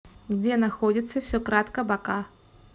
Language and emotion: Russian, neutral